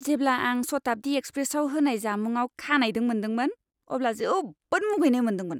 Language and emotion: Bodo, disgusted